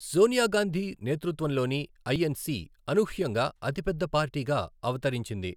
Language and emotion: Telugu, neutral